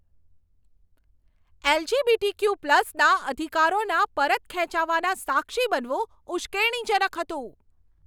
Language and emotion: Gujarati, angry